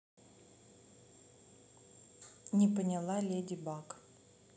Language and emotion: Russian, neutral